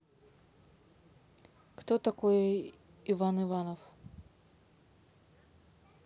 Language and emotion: Russian, neutral